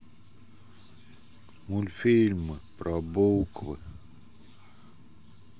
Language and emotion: Russian, sad